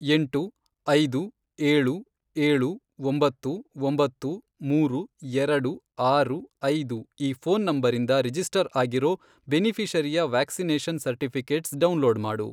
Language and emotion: Kannada, neutral